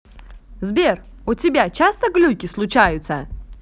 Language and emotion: Russian, positive